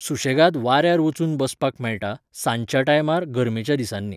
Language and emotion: Goan Konkani, neutral